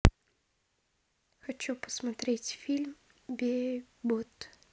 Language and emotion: Russian, neutral